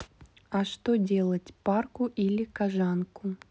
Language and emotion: Russian, neutral